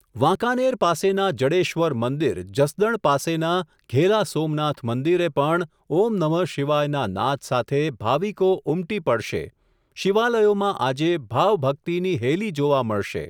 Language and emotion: Gujarati, neutral